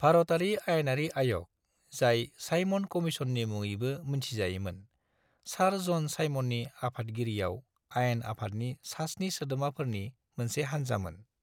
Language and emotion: Bodo, neutral